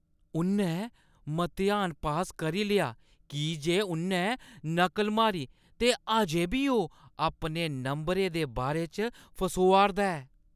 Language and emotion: Dogri, disgusted